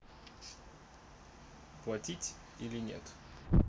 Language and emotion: Russian, neutral